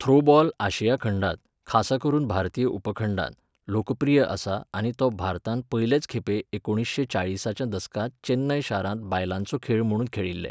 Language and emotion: Goan Konkani, neutral